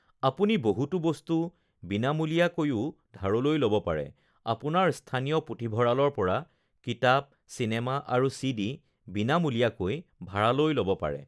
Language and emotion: Assamese, neutral